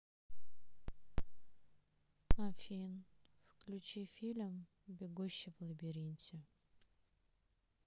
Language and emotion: Russian, sad